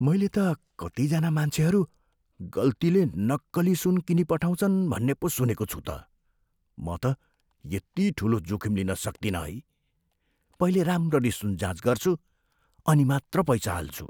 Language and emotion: Nepali, fearful